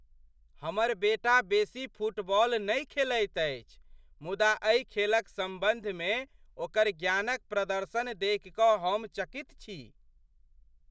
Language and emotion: Maithili, surprised